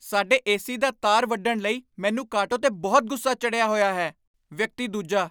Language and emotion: Punjabi, angry